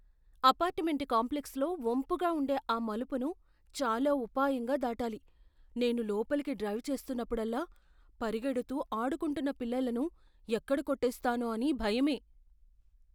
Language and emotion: Telugu, fearful